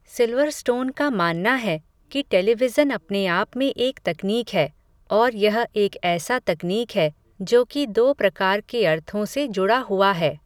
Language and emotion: Hindi, neutral